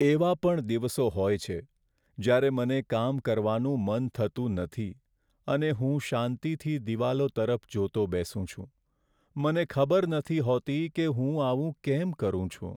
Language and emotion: Gujarati, sad